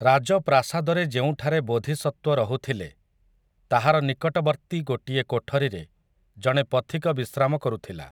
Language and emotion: Odia, neutral